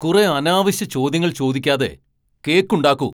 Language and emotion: Malayalam, angry